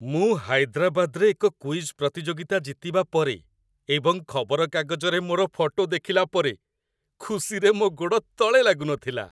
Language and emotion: Odia, happy